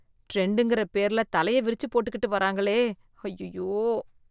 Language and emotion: Tamil, disgusted